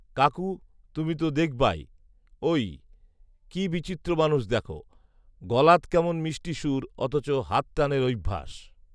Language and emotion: Bengali, neutral